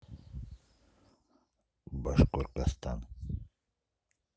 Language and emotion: Russian, neutral